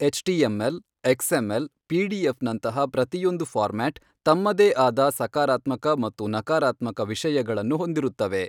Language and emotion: Kannada, neutral